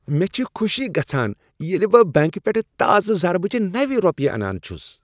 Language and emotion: Kashmiri, happy